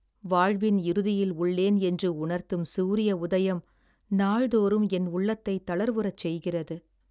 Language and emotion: Tamil, sad